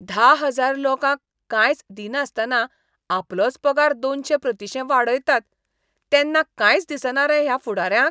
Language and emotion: Goan Konkani, disgusted